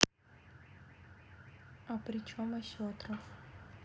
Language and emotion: Russian, neutral